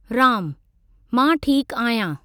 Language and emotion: Sindhi, neutral